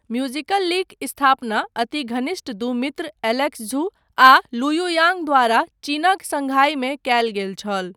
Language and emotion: Maithili, neutral